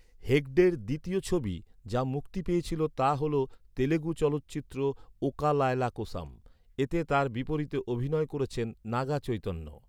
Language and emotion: Bengali, neutral